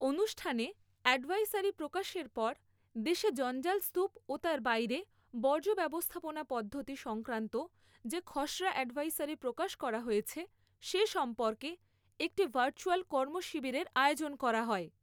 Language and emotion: Bengali, neutral